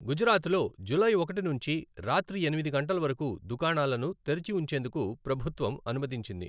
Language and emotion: Telugu, neutral